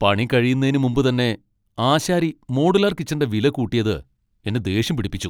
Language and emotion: Malayalam, angry